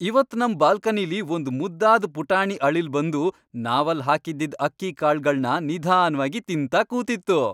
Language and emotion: Kannada, happy